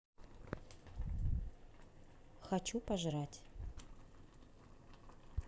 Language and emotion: Russian, neutral